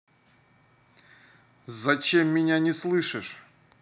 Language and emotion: Russian, angry